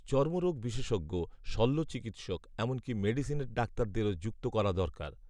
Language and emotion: Bengali, neutral